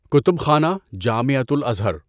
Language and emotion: Urdu, neutral